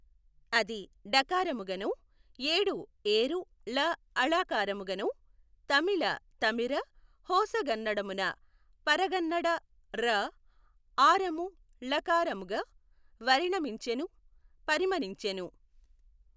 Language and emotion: Telugu, neutral